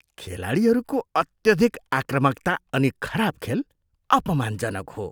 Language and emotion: Nepali, disgusted